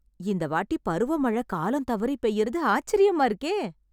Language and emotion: Tamil, surprised